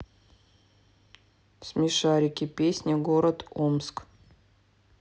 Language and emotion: Russian, neutral